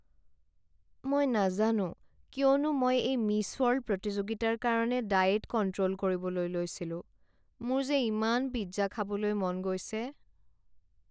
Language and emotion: Assamese, sad